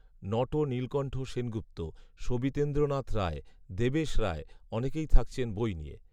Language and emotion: Bengali, neutral